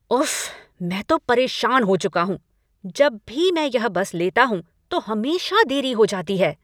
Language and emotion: Hindi, angry